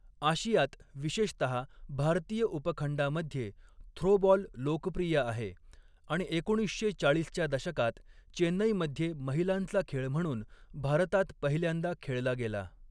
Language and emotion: Marathi, neutral